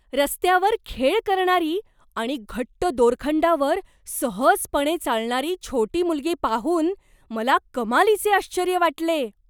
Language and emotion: Marathi, surprised